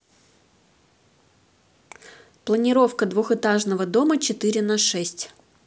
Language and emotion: Russian, neutral